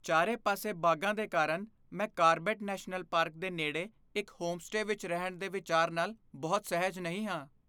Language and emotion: Punjabi, fearful